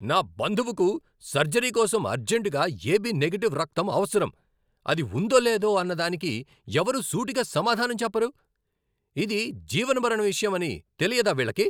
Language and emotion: Telugu, angry